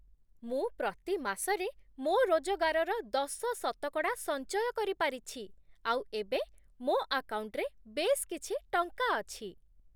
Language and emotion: Odia, happy